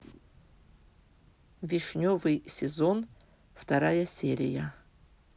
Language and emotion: Russian, neutral